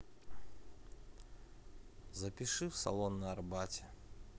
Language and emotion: Russian, neutral